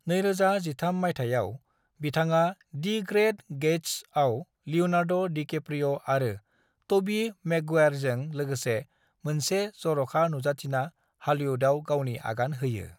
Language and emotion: Bodo, neutral